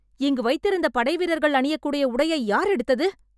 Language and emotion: Tamil, angry